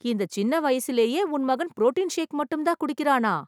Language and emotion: Tamil, surprised